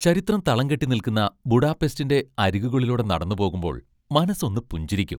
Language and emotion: Malayalam, happy